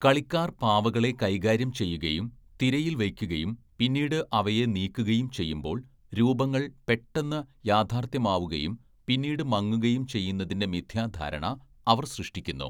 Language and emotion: Malayalam, neutral